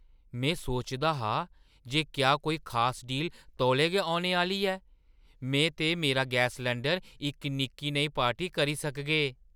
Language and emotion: Dogri, surprised